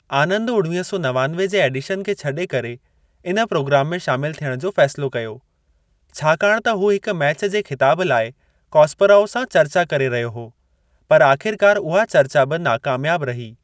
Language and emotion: Sindhi, neutral